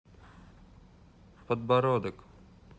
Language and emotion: Russian, neutral